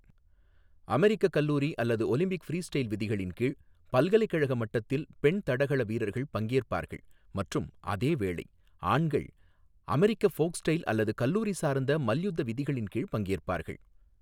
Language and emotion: Tamil, neutral